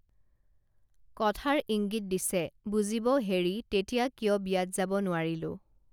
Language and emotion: Assamese, neutral